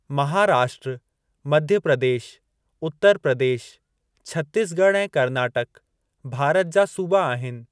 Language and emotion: Sindhi, neutral